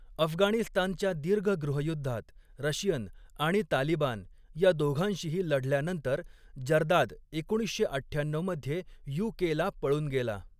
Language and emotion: Marathi, neutral